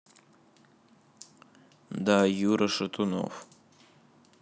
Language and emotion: Russian, neutral